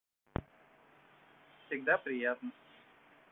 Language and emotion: Russian, neutral